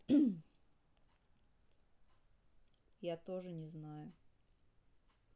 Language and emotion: Russian, sad